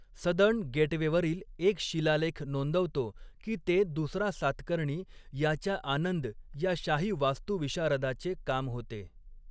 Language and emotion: Marathi, neutral